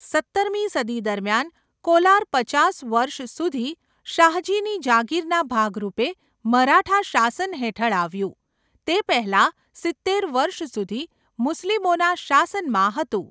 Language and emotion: Gujarati, neutral